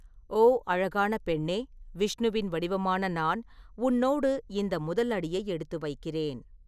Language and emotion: Tamil, neutral